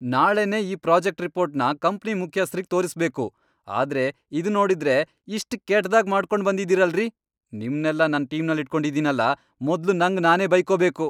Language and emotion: Kannada, angry